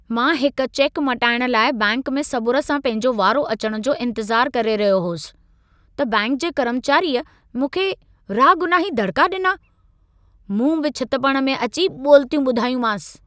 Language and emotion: Sindhi, angry